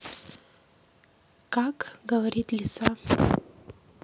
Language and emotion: Russian, neutral